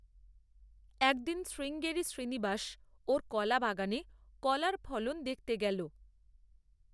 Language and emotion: Bengali, neutral